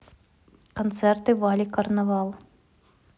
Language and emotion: Russian, neutral